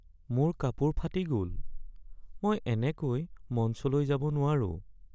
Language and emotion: Assamese, sad